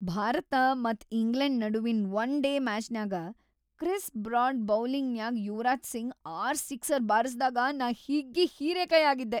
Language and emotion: Kannada, happy